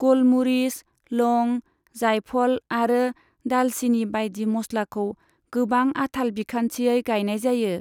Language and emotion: Bodo, neutral